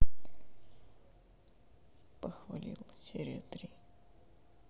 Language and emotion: Russian, sad